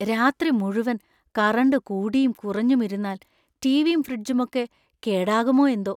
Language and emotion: Malayalam, fearful